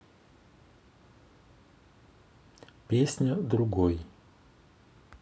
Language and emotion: Russian, neutral